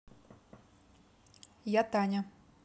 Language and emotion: Russian, neutral